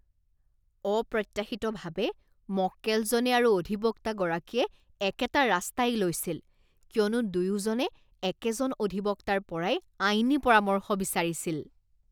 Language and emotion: Assamese, disgusted